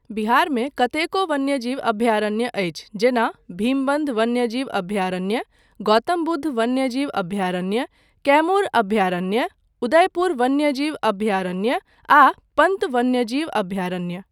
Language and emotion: Maithili, neutral